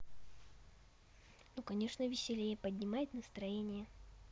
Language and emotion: Russian, positive